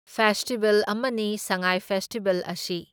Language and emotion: Manipuri, neutral